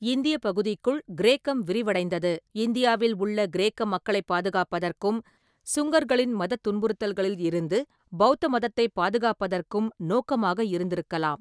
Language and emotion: Tamil, neutral